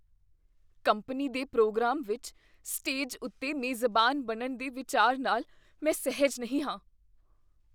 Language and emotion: Punjabi, fearful